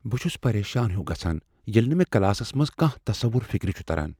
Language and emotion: Kashmiri, fearful